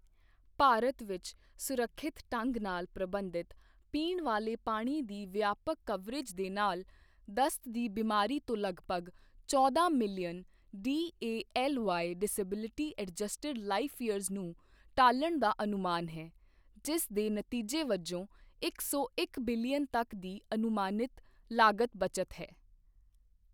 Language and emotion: Punjabi, neutral